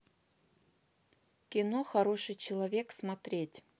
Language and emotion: Russian, neutral